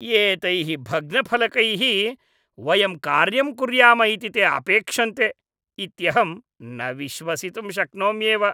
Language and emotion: Sanskrit, disgusted